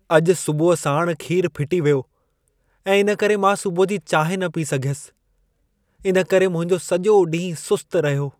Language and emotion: Sindhi, sad